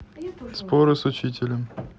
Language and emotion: Russian, neutral